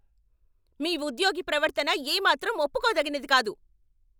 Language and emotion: Telugu, angry